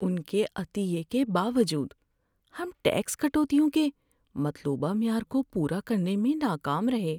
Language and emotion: Urdu, sad